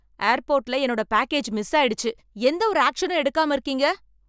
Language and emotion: Tamil, angry